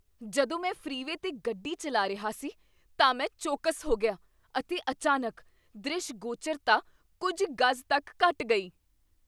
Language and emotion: Punjabi, surprised